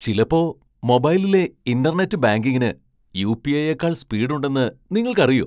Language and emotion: Malayalam, surprised